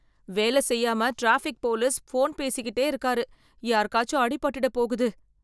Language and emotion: Tamil, fearful